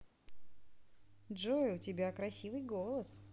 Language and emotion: Russian, positive